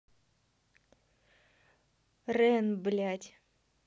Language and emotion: Russian, angry